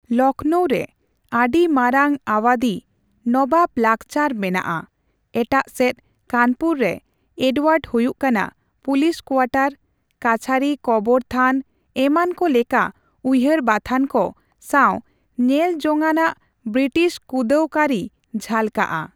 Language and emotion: Santali, neutral